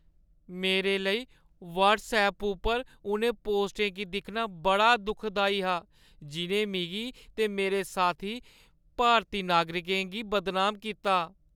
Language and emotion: Dogri, sad